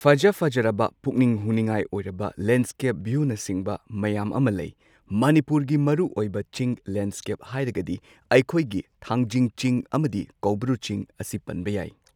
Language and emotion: Manipuri, neutral